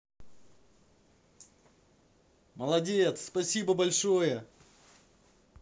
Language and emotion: Russian, positive